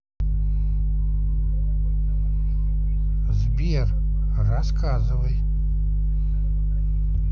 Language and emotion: Russian, neutral